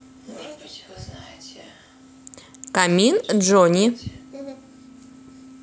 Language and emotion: Russian, neutral